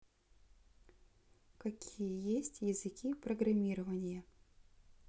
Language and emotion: Russian, neutral